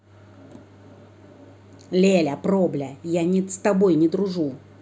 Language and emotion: Russian, angry